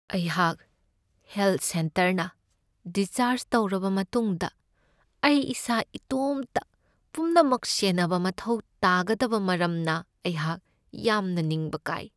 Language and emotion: Manipuri, sad